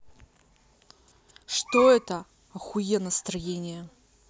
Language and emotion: Russian, angry